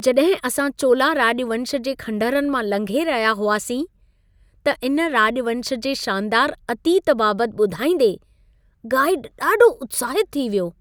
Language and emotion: Sindhi, happy